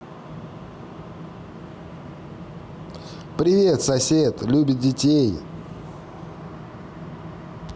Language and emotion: Russian, positive